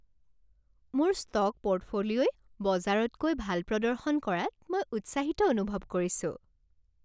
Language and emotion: Assamese, happy